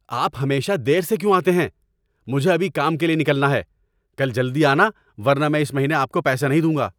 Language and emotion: Urdu, angry